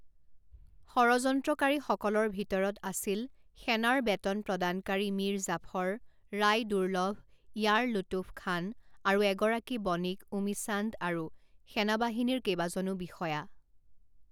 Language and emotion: Assamese, neutral